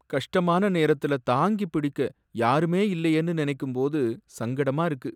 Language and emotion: Tamil, sad